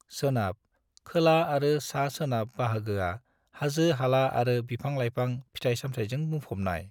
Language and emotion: Bodo, neutral